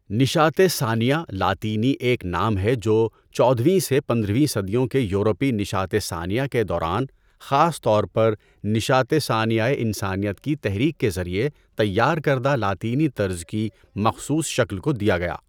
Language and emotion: Urdu, neutral